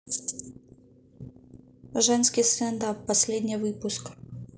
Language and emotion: Russian, neutral